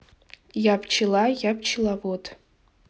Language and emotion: Russian, neutral